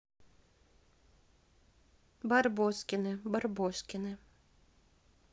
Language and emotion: Russian, neutral